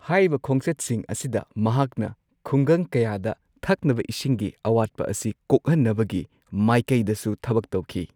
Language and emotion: Manipuri, neutral